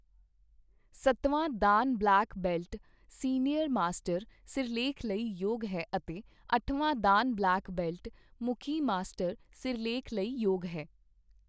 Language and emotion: Punjabi, neutral